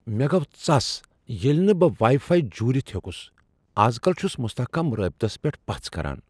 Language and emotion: Kashmiri, surprised